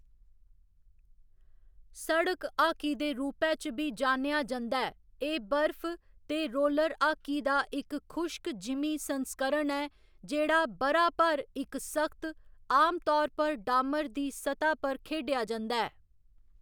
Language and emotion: Dogri, neutral